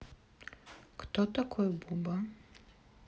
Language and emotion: Russian, neutral